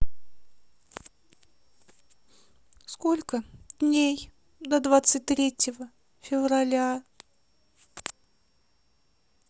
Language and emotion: Russian, sad